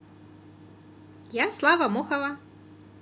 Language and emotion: Russian, positive